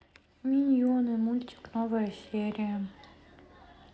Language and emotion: Russian, sad